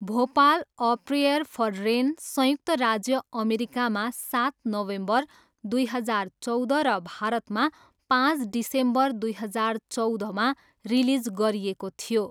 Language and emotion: Nepali, neutral